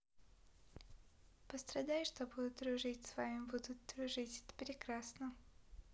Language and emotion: Russian, positive